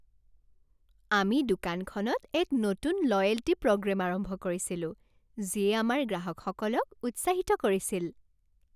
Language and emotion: Assamese, happy